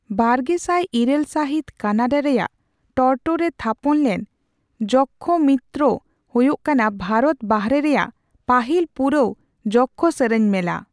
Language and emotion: Santali, neutral